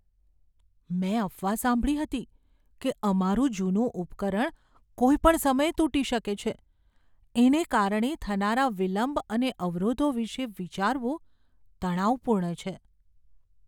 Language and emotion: Gujarati, fearful